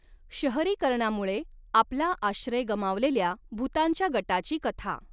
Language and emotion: Marathi, neutral